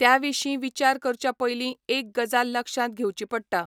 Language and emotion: Goan Konkani, neutral